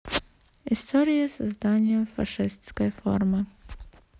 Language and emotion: Russian, neutral